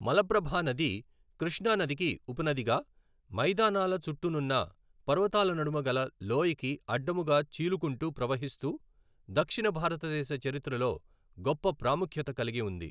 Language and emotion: Telugu, neutral